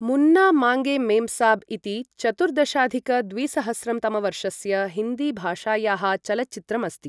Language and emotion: Sanskrit, neutral